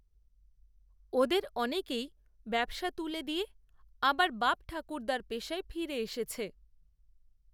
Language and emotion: Bengali, neutral